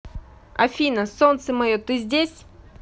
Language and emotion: Russian, positive